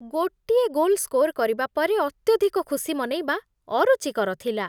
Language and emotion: Odia, disgusted